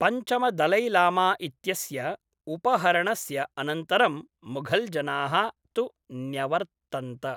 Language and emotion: Sanskrit, neutral